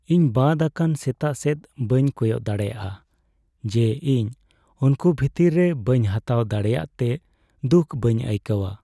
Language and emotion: Santali, sad